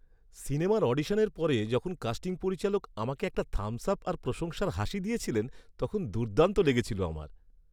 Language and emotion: Bengali, happy